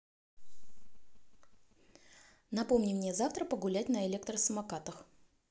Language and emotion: Russian, neutral